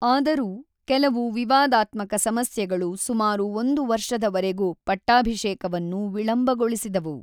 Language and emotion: Kannada, neutral